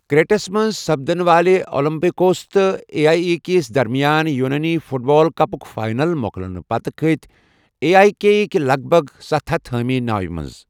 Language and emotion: Kashmiri, neutral